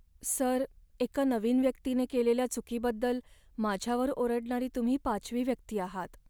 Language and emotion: Marathi, sad